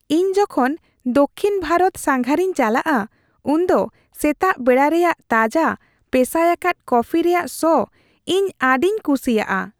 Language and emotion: Santali, happy